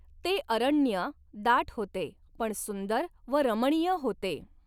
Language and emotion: Marathi, neutral